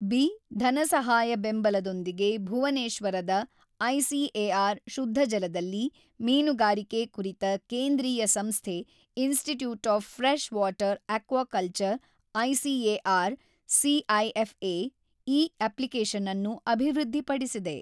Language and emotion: Kannada, neutral